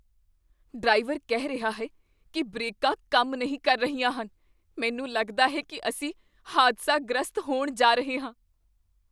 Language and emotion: Punjabi, fearful